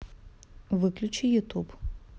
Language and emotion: Russian, neutral